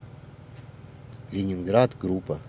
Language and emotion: Russian, neutral